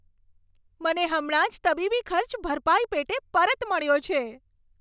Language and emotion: Gujarati, happy